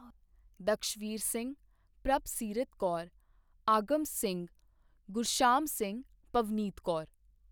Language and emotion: Punjabi, neutral